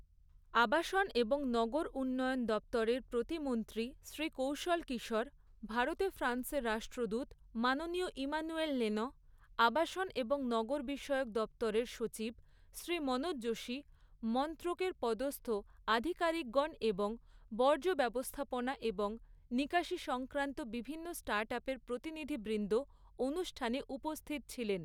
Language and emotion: Bengali, neutral